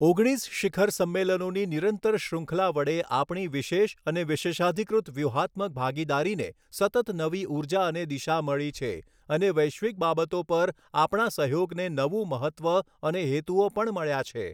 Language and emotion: Gujarati, neutral